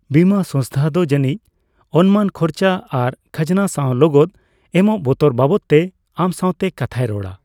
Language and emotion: Santali, neutral